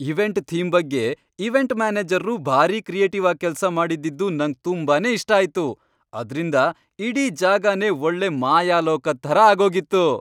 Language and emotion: Kannada, happy